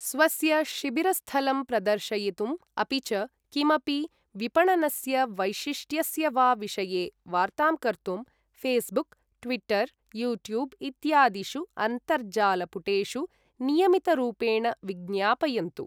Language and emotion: Sanskrit, neutral